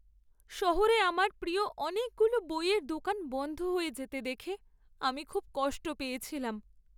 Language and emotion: Bengali, sad